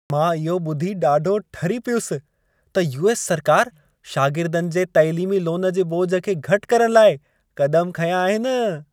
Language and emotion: Sindhi, happy